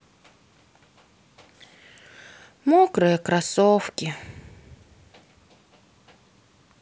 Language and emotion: Russian, sad